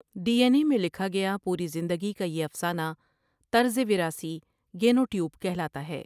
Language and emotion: Urdu, neutral